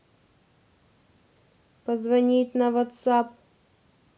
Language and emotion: Russian, neutral